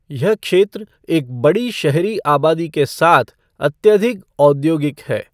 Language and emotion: Hindi, neutral